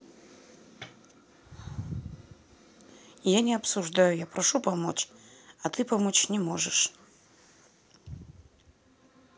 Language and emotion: Russian, sad